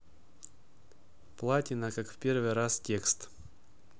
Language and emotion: Russian, neutral